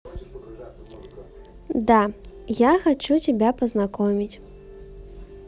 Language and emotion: Russian, neutral